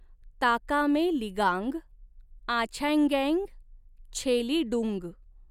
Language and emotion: Marathi, neutral